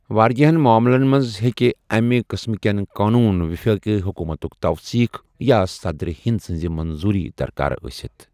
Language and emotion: Kashmiri, neutral